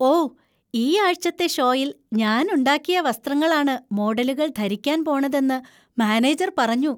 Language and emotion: Malayalam, happy